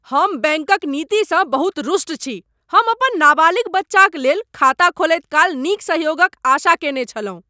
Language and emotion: Maithili, angry